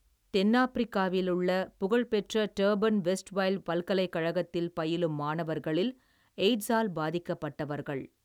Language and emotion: Tamil, neutral